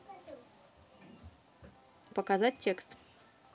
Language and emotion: Russian, neutral